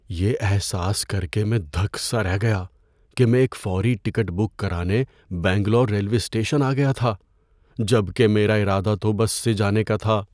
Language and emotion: Urdu, fearful